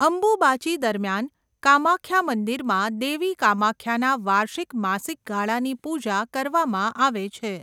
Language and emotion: Gujarati, neutral